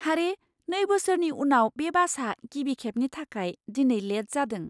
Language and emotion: Bodo, surprised